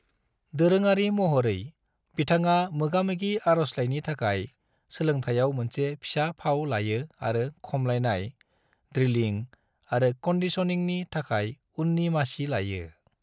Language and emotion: Bodo, neutral